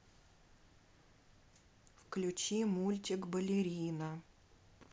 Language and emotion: Russian, neutral